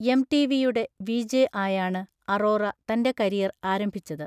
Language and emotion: Malayalam, neutral